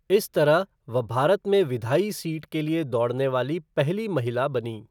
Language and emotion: Hindi, neutral